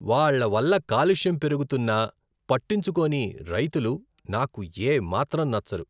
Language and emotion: Telugu, disgusted